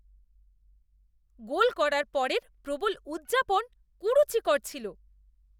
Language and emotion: Bengali, disgusted